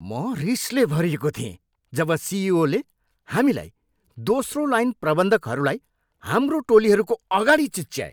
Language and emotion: Nepali, angry